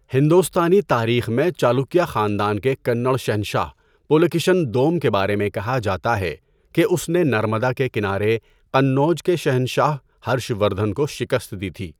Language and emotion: Urdu, neutral